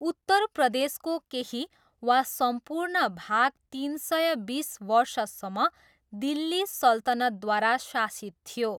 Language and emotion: Nepali, neutral